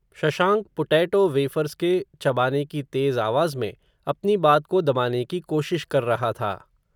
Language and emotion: Hindi, neutral